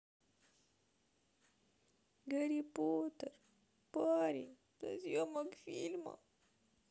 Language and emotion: Russian, sad